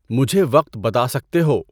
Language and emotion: Urdu, neutral